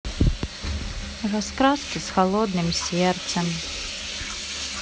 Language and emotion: Russian, sad